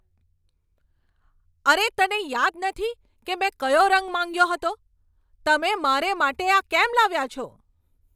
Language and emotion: Gujarati, angry